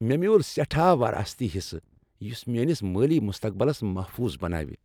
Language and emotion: Kashmiri, happy